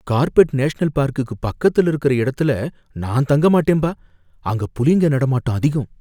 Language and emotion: Tamil, fearful